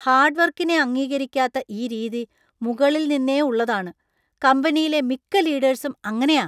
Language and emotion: Malayalam, disgusted